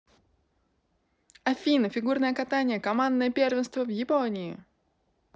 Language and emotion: Russian, positive